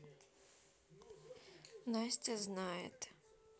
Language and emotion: Russian, sad